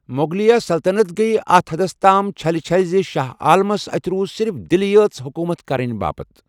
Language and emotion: Kashmiri, neutral